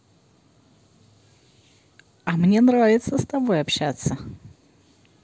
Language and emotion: Russian, positive